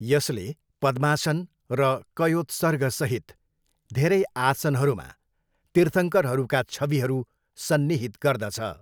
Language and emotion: Nepali, neutral